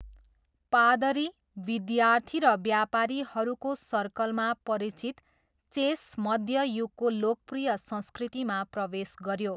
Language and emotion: Nepali, neutral